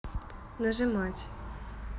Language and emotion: Russian, neutral